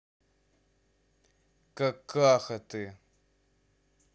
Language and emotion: Russian, angry